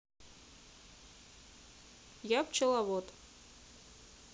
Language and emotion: Russian, neutral